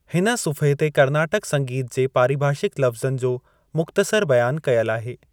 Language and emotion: Sindhi, neutral